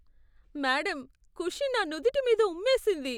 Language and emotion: Telugu, disgusted